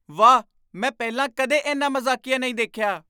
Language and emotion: Punjabi, surprised